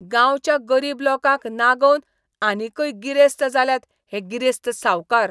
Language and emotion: Goan Konkani, disgusted